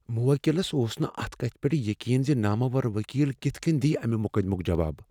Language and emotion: Kashmiri, fearful